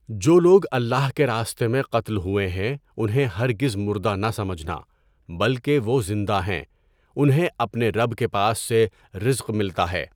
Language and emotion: Urdu, neutral